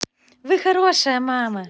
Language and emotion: Russian, positive